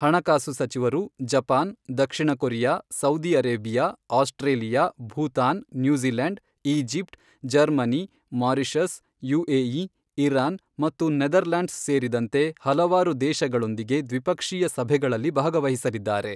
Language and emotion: Kannada, neutral